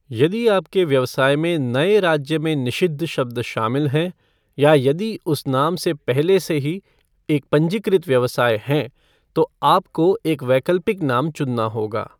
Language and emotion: Hindi, neutral